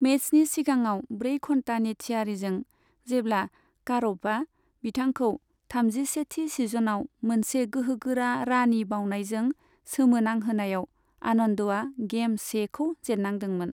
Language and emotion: Bodo, neutral